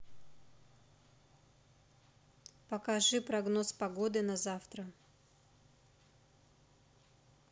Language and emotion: Russian, neutral